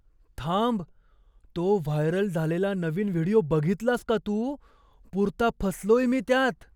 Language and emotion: Marathi, surprised